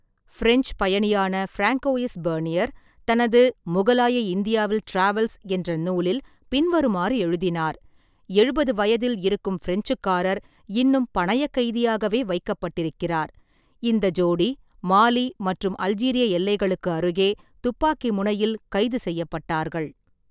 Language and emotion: Tamil, neutral